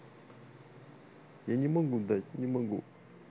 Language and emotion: Russian, sad